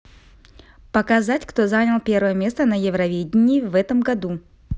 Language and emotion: Russian, neutral